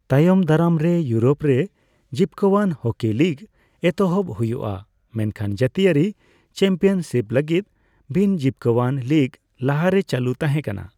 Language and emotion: Santali, neutral